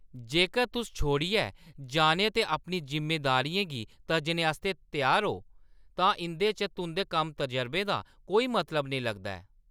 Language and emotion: Dogri, angry